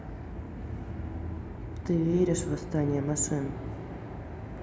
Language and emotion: Russian, neutral